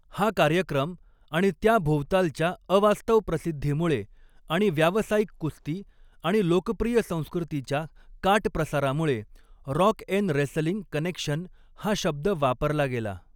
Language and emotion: Marathi, neutral